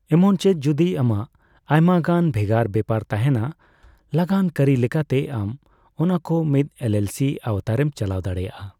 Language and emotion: Santali, neutral